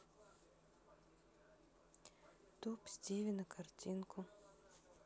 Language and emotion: Russian, sad